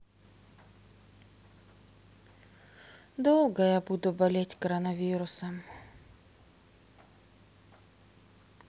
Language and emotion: Russian, sad